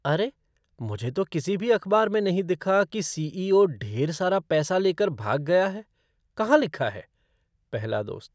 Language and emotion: Hindi, surprised